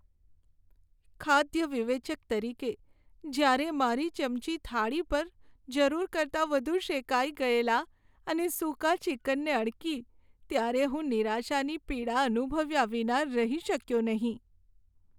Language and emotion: Gujarati, sad